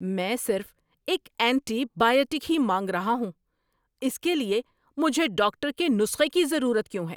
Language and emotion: Urdu, angry